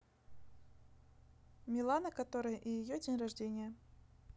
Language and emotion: Russian, neutral